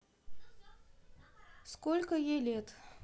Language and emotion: Russian, neutral